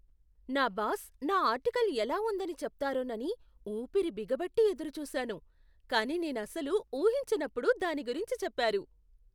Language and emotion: Telugu, surprised